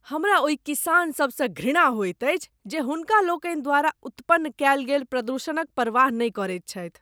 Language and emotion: Maithili, disgusted